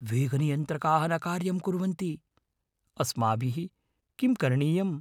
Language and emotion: Sanskrit, fearful